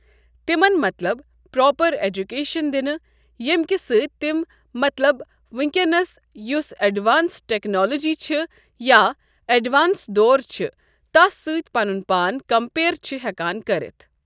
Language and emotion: Kashmiri, neutral